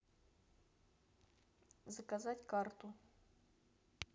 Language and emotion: Russian, neutral